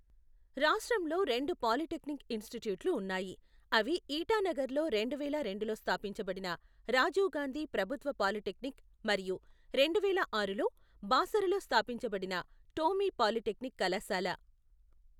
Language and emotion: Telugu, neutral